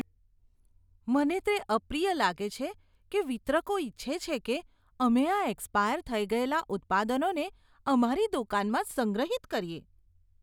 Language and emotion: Gujarati, disgusted